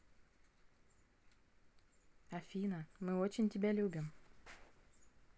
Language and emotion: Russian, positive